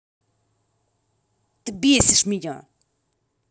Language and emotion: Russian, angry